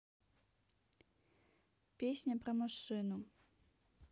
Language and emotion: Russian, neutral